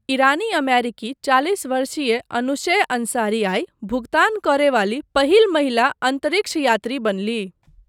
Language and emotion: Maithili, neutral